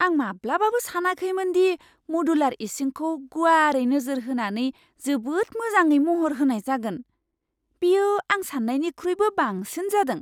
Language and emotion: Bodo, surprised